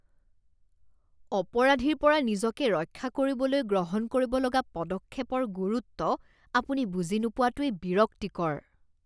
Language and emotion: Assamese, disgusted